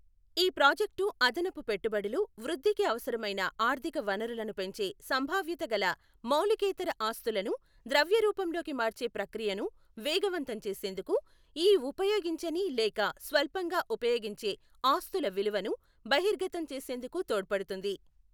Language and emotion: Telugu, neutral